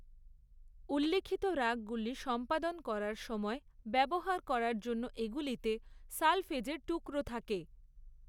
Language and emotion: Bengali, neutral